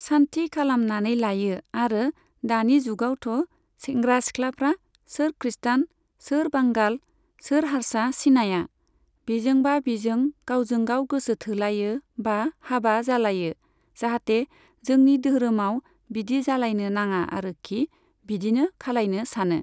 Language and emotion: Bodo, neutral